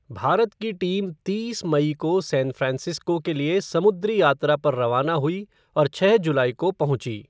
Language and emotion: Hindi, neutral